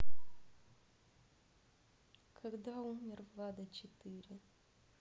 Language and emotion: Russian, sad